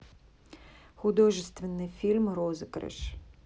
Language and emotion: Russian, neutral